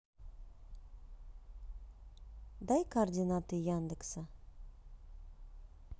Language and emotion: Russian, neutral